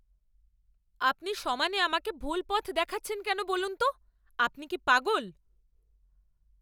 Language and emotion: Bengali, angry